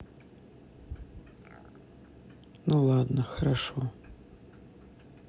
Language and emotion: Russian, neutral